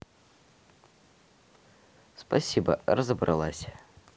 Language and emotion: Russian, neutral